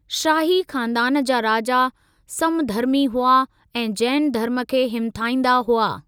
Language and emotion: Sindhi, neutral